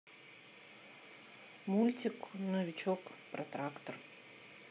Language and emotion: Russian, neutral